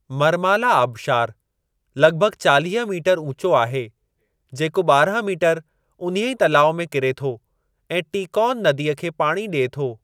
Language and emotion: Sindhi, neutral